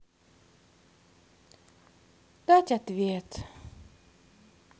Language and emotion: Russian, sad